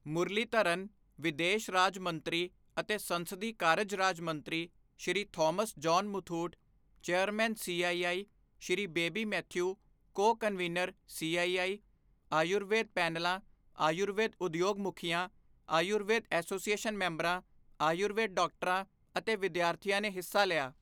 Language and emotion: Punjabi, neutral